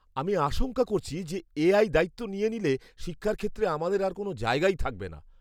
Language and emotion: Bengali, fearful